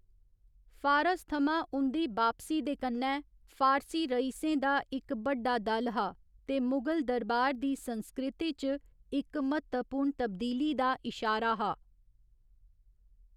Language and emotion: Dogri, neutral